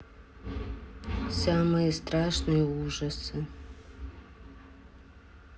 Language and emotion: Russian, sad